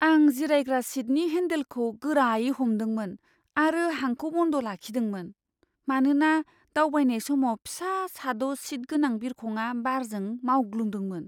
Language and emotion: Bodo, fearful